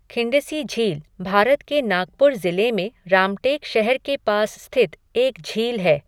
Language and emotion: Hindi, neutral